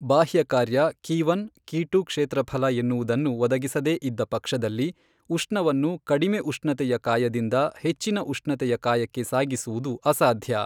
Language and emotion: Kannada, neutral